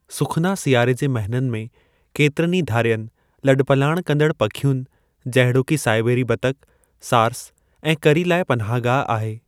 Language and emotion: Sindhi, neutral